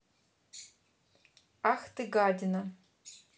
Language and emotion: Russian, neutral